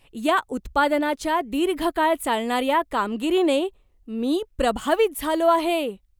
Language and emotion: Marathi, surprised